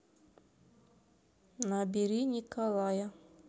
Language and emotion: Russian, neutral